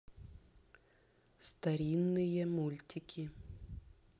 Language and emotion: Russian, neutral